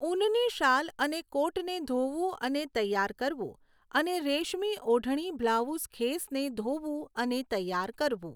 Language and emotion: Gujarati, neutral